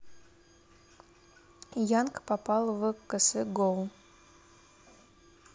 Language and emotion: Russian, neutral